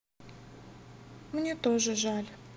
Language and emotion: Russian, sad